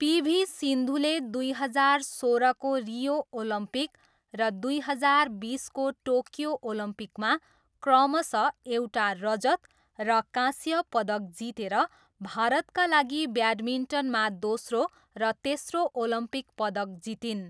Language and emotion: Nepali, neutral